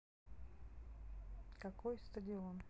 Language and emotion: Russian, neutral